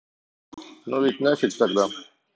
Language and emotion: Russian, neutral